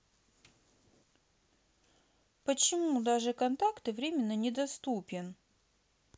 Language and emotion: Russian, sad